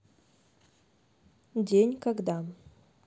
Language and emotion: Russian, neutral